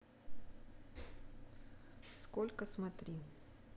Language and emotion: Russian, neutral